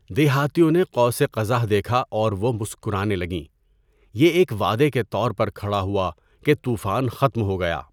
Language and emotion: Urdu, neutral